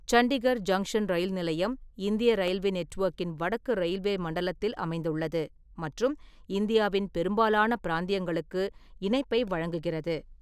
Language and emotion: Tamil, neutral